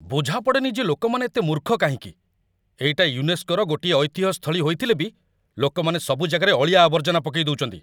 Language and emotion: Odia, angry